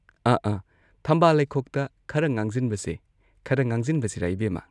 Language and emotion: Manipuri, neutral